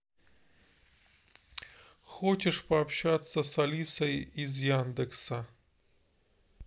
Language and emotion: Russian, neutral